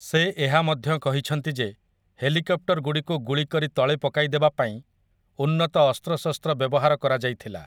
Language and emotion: Odia, neutral